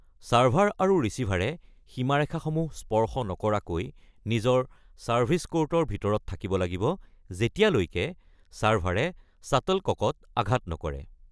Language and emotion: Assamese, neutral